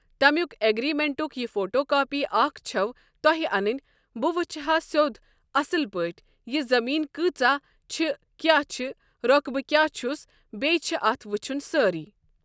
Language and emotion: Kashmiri, neutral